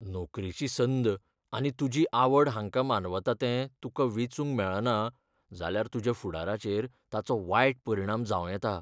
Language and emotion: Goan Konkani, fearful